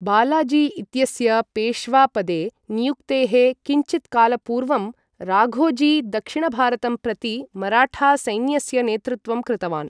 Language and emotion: Sanskrit, neutral